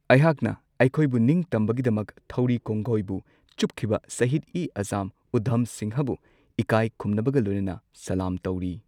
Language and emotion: Manipuri, neutral